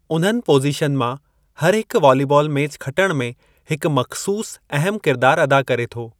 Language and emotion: Sindhi, neutral